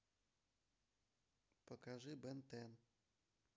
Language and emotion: Russian, neutral